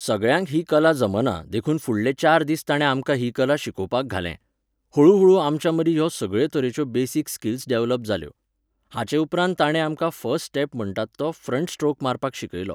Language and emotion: Goan Konkani, neutral